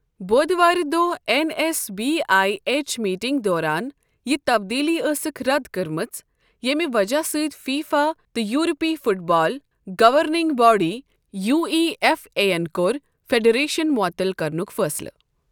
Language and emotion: Kashmiri, neutral